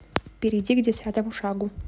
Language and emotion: Russian, neutral